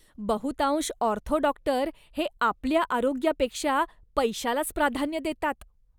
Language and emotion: Marathi, disgusted